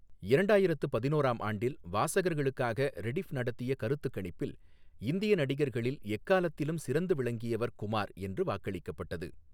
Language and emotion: Tamil, neutral